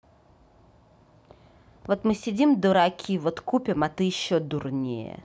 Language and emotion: Russian, angry